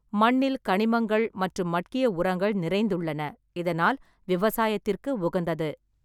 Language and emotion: Tamil, neutral